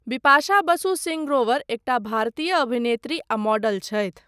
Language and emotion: Maithili, neutral